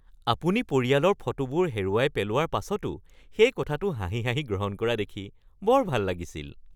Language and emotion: Assamese, happy